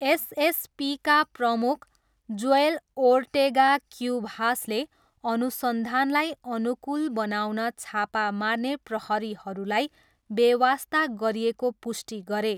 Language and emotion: Nepali, neutral